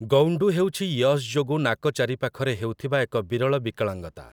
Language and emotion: Odia, neutral